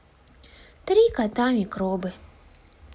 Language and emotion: Russian, sad